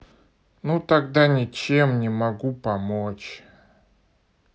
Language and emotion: Russian, neutral